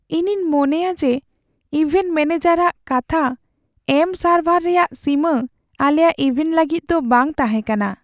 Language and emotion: Santali, sad